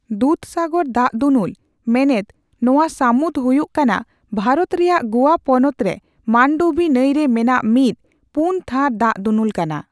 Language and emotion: Santali, neutral